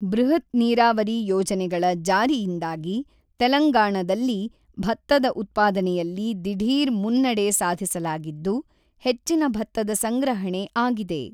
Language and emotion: Kannada, neutral